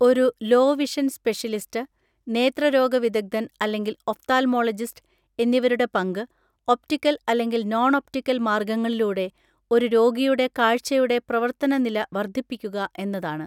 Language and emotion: Malayalam, neutral